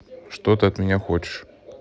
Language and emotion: Russian, angry